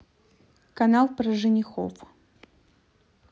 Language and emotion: Russian, neutral